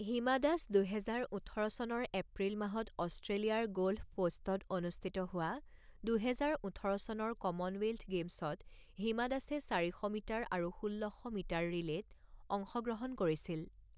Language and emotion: Assamese, neutral